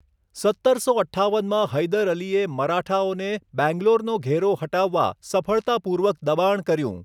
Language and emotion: Gujarati, neutral